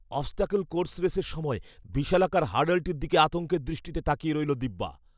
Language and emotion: Bengali, fearful